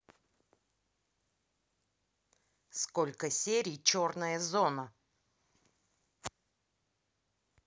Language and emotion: Russian, neutral